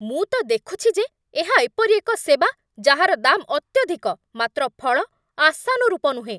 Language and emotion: Odia, angry